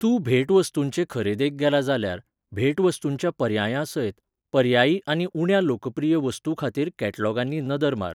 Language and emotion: Goan Konkani, neutral